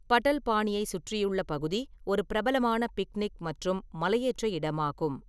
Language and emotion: Tamil, neutral